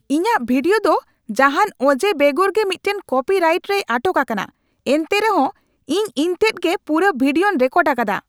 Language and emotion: Santali, angry